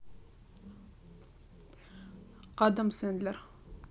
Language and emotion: Russian, neutral